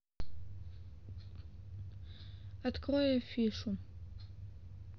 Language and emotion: Russian, neutral